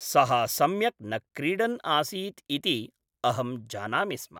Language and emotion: Sanskrit, neutral